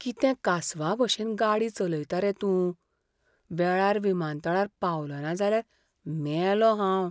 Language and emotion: Goan Konkani, fearful